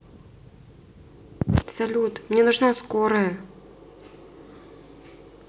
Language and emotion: Russian, sad